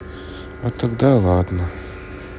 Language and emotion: Russian, sad